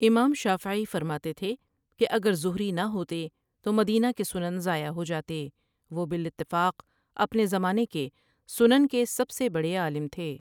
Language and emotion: Urdu, neutral